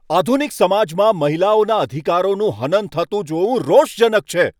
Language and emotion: Gujarati, angry